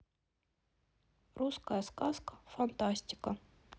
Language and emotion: Russian, neutral